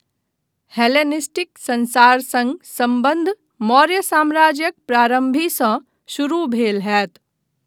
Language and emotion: Maithili, neutral